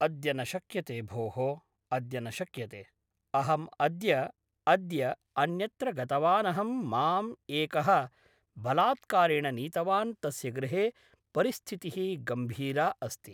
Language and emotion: Sanskrit, neutral